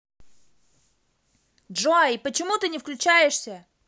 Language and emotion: Russian, angry